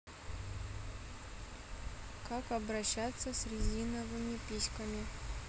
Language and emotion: Russian, neutral